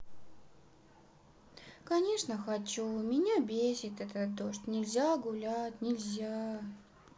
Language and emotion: Russian, sad